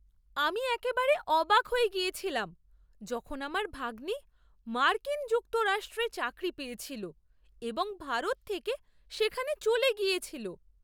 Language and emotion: Bengali, surprised